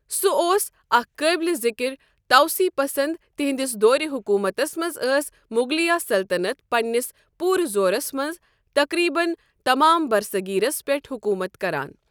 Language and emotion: Kashmiri, neutral